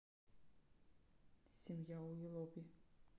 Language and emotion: Russian, neutral